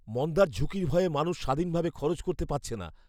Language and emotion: Bengali, fearful